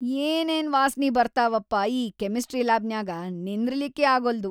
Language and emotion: Kannada, disgusted